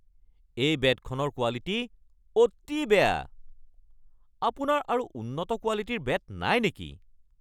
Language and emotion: Assamese, angry